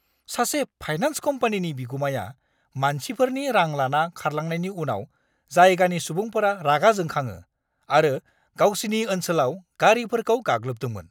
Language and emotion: Bodo, angry